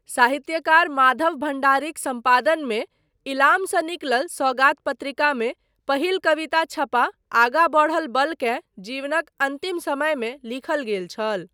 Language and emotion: Maithili, neutral